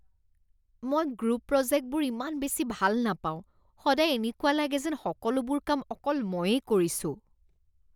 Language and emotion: Assamese, disgusted